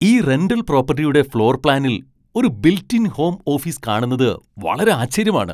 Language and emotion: Malayalam, surprised